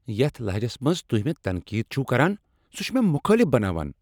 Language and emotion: Kashmiri, angry